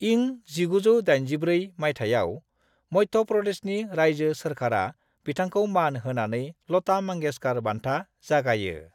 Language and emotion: Bodo, neutral